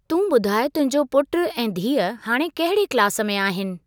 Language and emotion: Sindhi, neutral